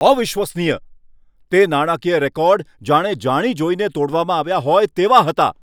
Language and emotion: Gujarati, angry